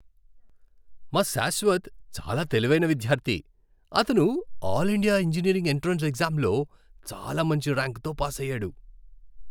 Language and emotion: Telugu, happy